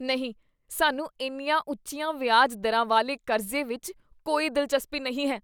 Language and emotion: Punjabi, disgusted